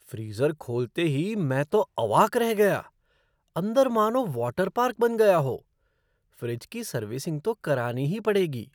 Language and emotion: Hindi, surprised